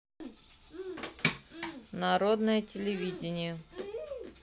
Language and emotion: Russian, neutral